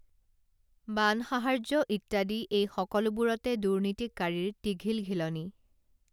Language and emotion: Assamese, neutral